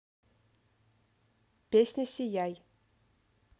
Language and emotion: Russian, neutral